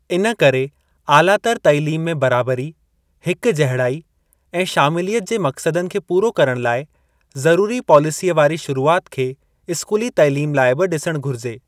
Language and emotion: Sindhi, neutral